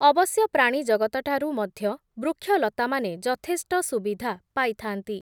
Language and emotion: Odia, neutral